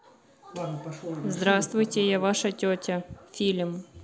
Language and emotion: Russian, neutral